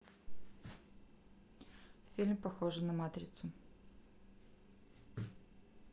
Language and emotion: Russian, neutral